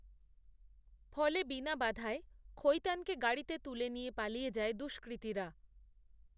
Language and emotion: Bengali, neutral